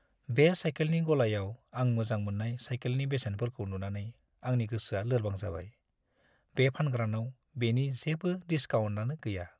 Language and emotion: Bodo, sad